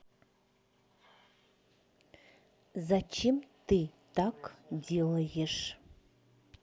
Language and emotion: Russian, neutral